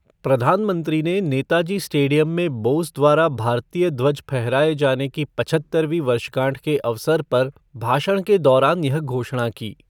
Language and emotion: Hindi, neutral